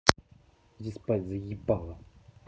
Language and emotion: Russian, angry